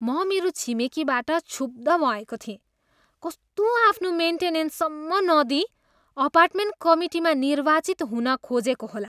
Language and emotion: Nepali, disgusted